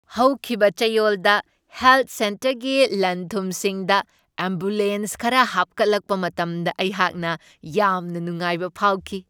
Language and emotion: Manipuri, happy